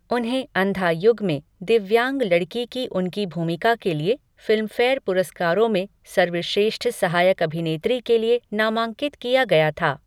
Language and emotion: Hindi, neutral